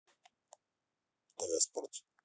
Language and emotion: Russian, neutral